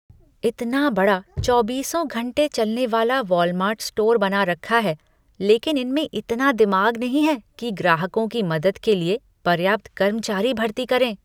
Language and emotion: Hindi, disgusted